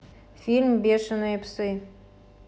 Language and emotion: Russian, neutral